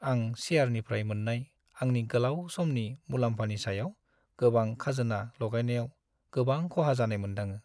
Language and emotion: Bodo, sad